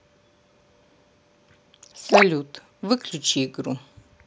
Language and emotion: Russian, neutral